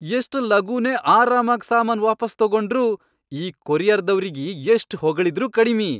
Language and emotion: Kannada, happy